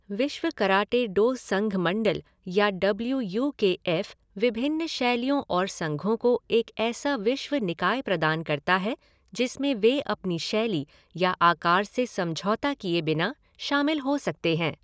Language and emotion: Hindi, neutral